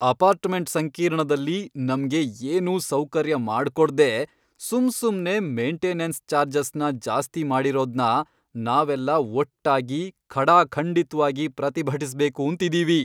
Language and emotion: Kannada, angry